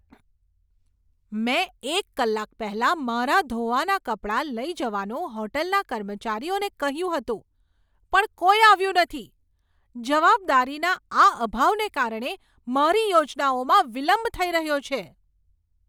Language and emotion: Gujarati, angry